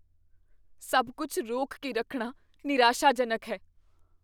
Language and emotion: Punjabi, fearful